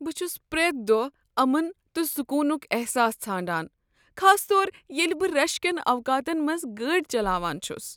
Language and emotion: Kashmiri, sad